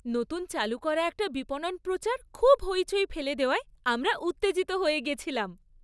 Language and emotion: Bengali, happy